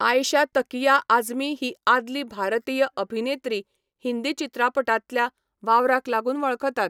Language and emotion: Goan Konkani, neutral